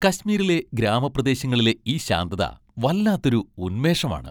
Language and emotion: Malayalam, happy